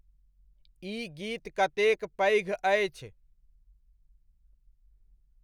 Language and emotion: Maithili, neutral